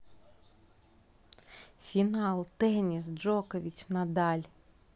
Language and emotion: Russian, positive